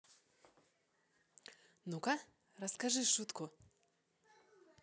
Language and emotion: Russian, positive